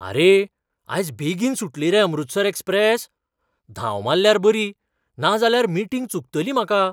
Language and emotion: Goan Konkani, surprised